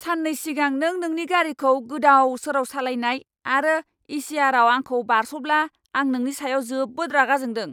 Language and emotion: Bodo, angry